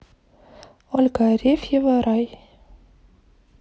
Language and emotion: Russian, neutral